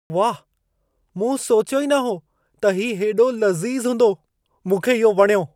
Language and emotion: Sindhi, surprised